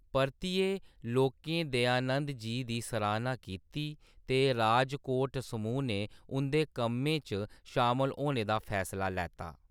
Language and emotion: Dogri, neutral